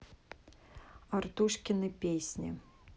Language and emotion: Russian, neutral